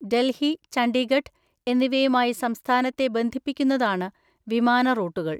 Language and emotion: Malayalam, neutral